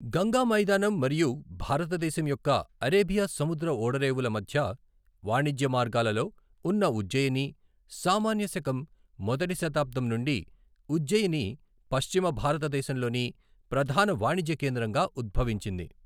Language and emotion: Telugu, neutral